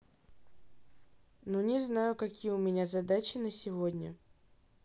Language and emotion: Russian, neutral